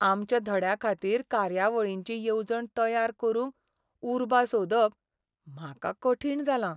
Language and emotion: Goan Konkani, sad